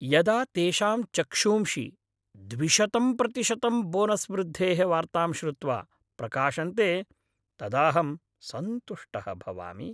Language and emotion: Sanskrit, happy